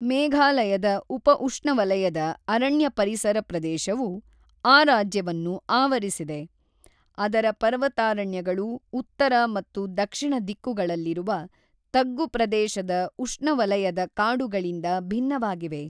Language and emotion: Kannada, neutral